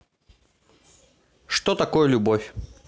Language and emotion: Russian, neutral